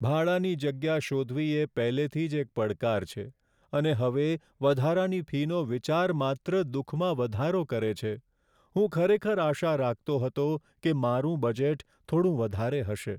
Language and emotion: Gujarati, sad